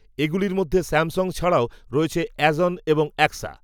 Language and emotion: Bengali, neutral